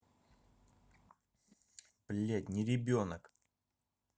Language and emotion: Russian, angry